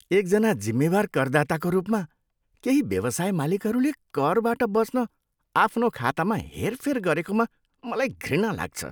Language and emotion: Nepali, disgusted